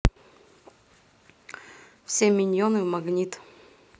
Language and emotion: Russian, neutral